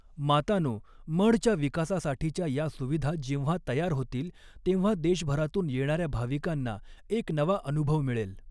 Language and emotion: Marathi, neutral